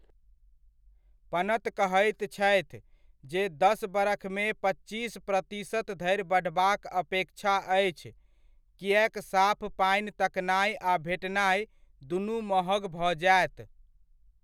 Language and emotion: Maithili, neutral